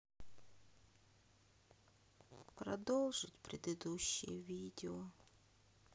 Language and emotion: Russian, sad